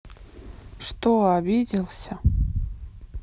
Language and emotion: Russian, sad